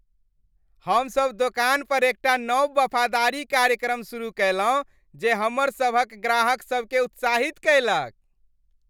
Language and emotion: Maithili, happy